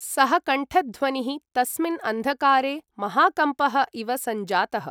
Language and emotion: Sanskrit, neutral